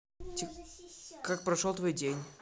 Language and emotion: Russian, neutral